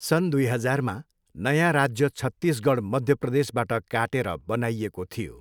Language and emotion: Nepali, neutral